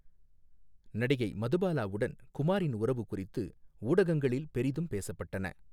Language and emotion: Tamil, neutral